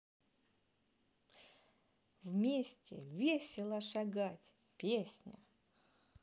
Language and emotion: Russian, positive